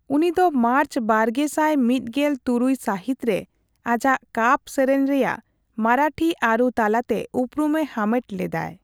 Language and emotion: Santali, neutral